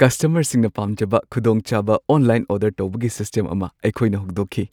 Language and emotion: Manipuri, happy